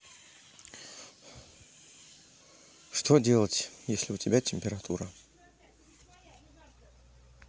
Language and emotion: Russian, sad